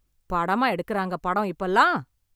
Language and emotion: Tamil, angry